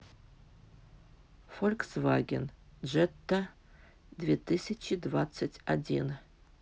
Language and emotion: Russian, neutral